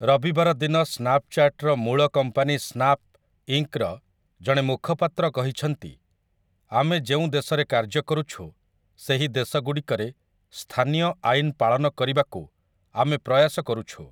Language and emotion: Odia, neutral